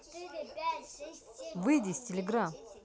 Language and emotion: Russian, angry